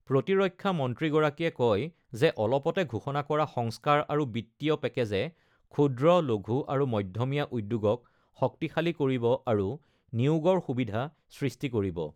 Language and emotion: Assamese, neutral